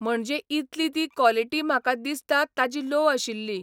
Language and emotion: Goan Konkani, neutral